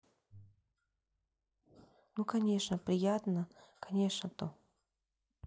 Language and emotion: Russian, neutral